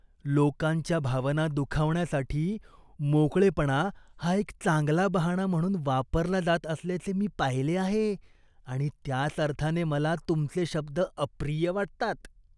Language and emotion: Marathi, disgusted